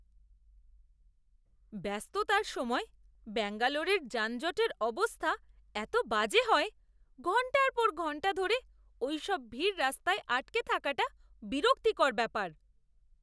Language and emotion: Bengali, disgusted